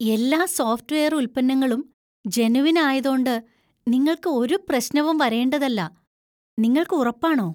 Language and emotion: Malayalam, surprised